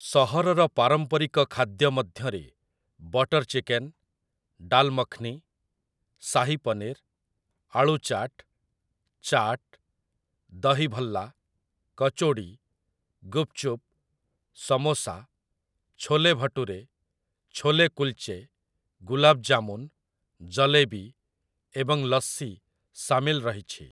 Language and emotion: Odia, neutral